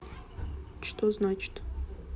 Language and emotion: Russian, neutral